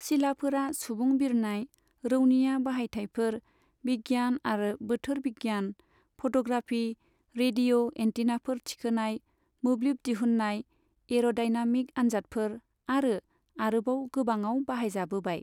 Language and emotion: Bodo, neutral